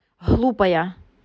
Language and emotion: Russian, angry